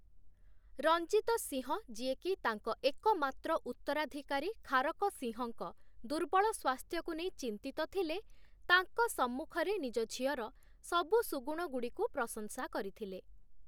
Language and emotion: Odia, neutral